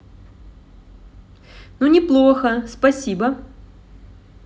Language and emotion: Russian, positive